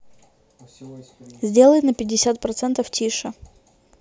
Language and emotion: Russian, neutral